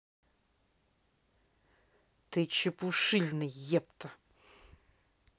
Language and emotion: Russian, angry